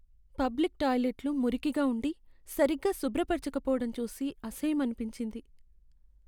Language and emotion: Telugu, sad